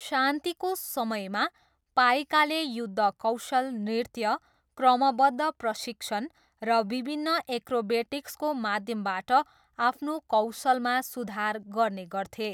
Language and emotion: Nepali, neutral